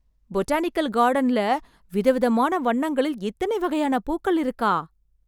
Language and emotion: Tamil, surprised